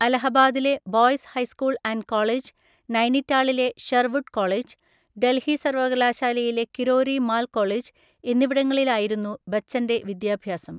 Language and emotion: Malayalam, neutral